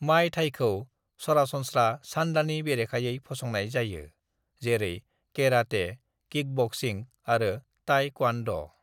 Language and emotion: Bodo, neutral